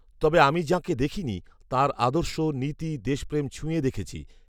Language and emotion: Bengali, neutral